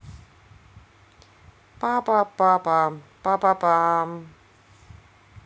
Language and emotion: Russian, positive